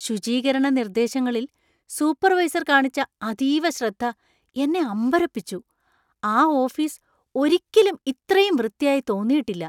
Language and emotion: Malayalam, surprised